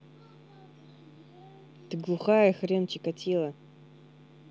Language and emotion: Russian, angry